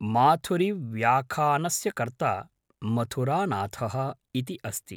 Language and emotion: Sanskrit, neutral